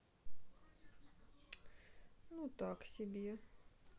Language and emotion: Russian, sad